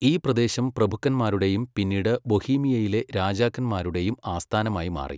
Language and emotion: Malayalam, neutral